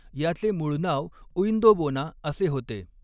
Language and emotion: Marathi, neutral